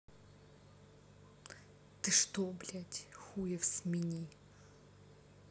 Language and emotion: Russian, angry